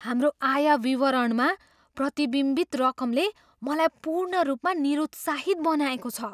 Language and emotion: Nepali, surprised